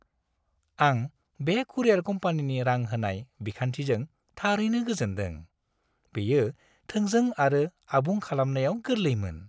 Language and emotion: Bodo, happy